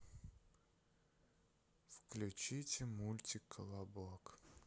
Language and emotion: Russian, sad